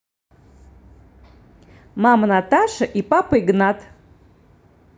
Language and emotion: Russian, positive